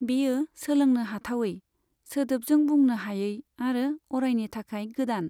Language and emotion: Bodo, neutral